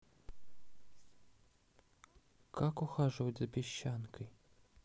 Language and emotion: Russian, neutral